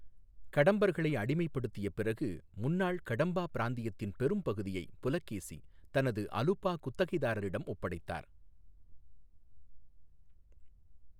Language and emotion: Tamil, neutral